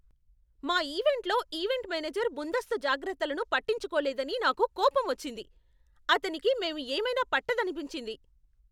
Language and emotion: Telugu, angry